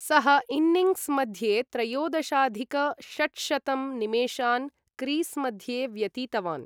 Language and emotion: Sanskrit, neutral